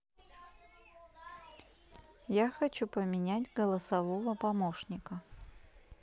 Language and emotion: Russian, neutral